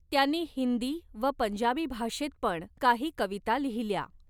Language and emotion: Marathi, neutral